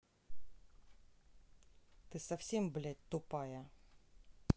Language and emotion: Russian, angry